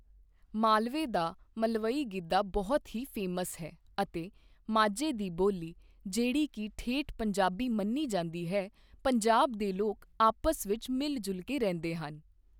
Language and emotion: Punjabi, neutral